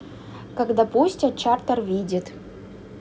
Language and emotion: Russian, neutral